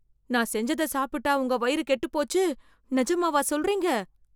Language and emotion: Tamil, fearful